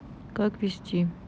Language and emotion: Russian, neutral